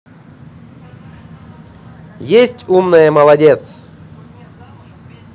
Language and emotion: Russian, positive